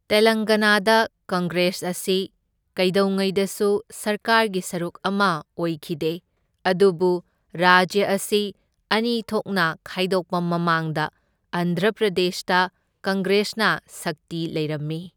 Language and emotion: Manipuri, neutral